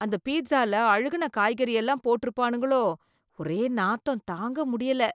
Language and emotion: Tamil, disgusted